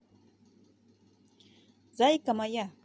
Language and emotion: Russian, positive